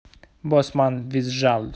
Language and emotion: Russian, neutral